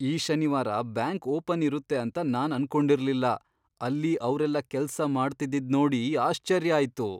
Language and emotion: Kannada, surprised